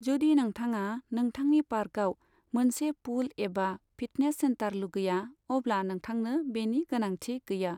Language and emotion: Bodo, neutral